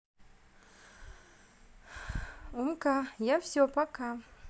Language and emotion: Russian, sad